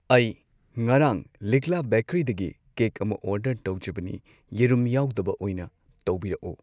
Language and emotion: Manipuri, neutral